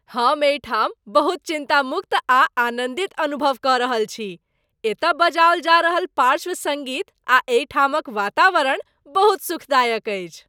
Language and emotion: Maithili, happy